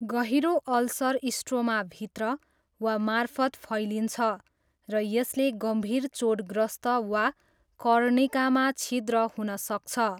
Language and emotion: Nepali, neutral